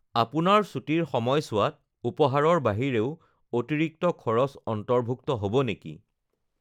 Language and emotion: Assamese, neutral